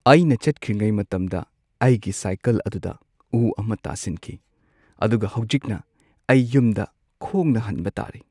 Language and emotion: Manipuri, sad